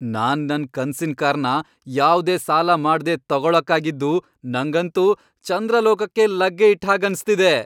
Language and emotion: Kannada, happy